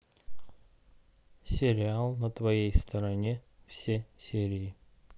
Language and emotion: Russian, neutral